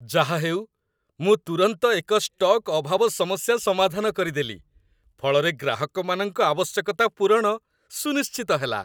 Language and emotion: Odia, happy